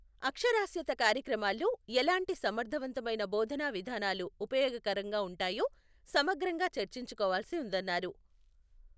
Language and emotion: Telugu, neutral